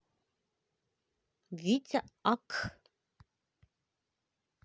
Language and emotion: Russian, neutral